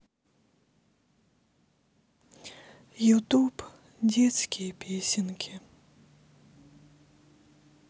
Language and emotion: Russian, sad